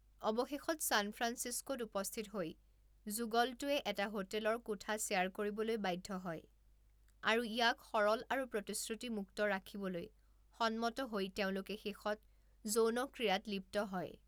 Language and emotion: Assamese, neutral